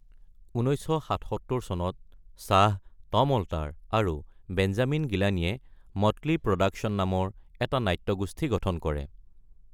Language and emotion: Assamese, neutral